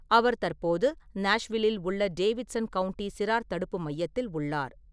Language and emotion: Tamil, neutral